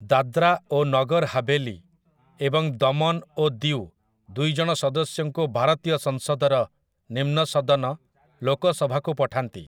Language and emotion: Odia, neutral